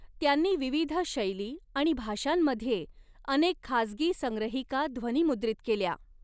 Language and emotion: Marathi, neutral